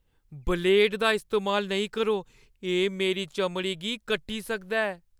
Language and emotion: Dogri, fearful